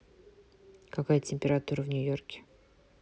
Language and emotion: Russian, neutral